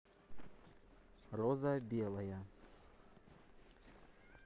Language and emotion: Russian, neutral